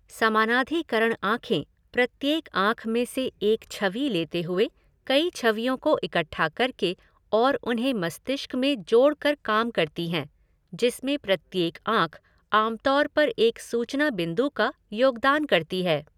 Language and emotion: Hindi, neutral